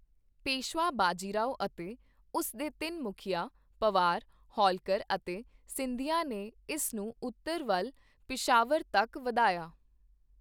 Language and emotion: Punjabi, neutral